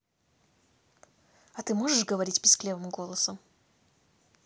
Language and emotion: Russian, neutral